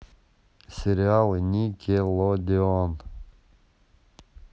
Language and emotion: Russian, neutral